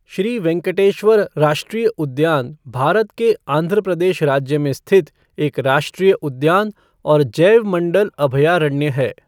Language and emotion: Hindi, neutral